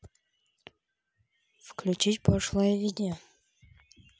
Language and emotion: Russian, neutral